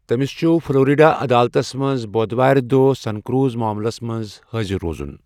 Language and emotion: Kashmiri, neutral